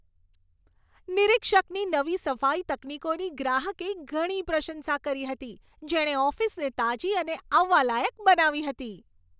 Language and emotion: Gujarati, happy